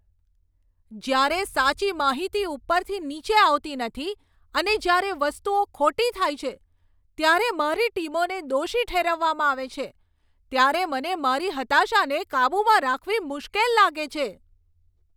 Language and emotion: Gujarati, angry